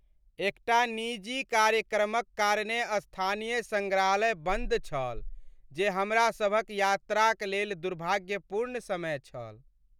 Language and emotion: Maithili, sad